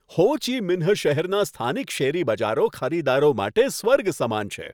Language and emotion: Gujarati, happy